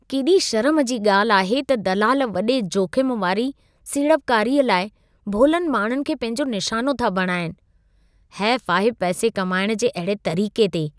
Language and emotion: Sindhi, disgusted